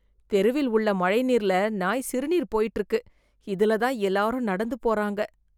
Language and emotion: Tamil, disgusted